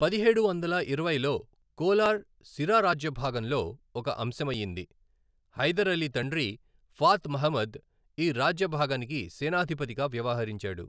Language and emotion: Telugu, neutral